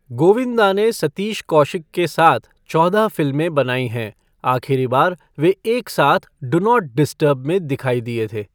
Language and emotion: Hindi, neutral